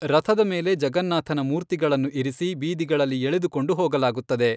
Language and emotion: Kannada, neutral